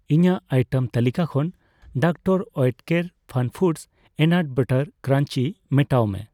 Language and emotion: Santali, neutral